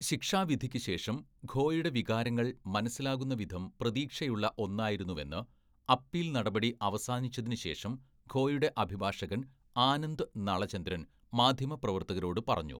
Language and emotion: Malayalam, neutral